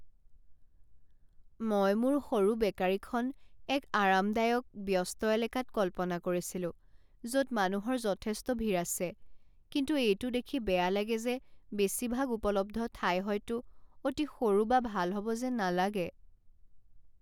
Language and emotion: Assamese, sad